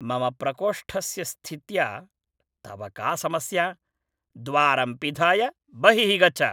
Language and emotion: Sanskrit, angry